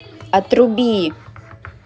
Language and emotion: Russian, angry